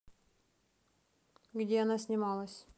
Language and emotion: Russian, neutral